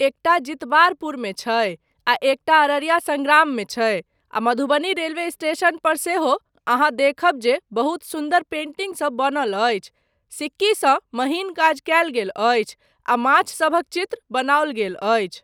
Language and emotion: Maithili, neutral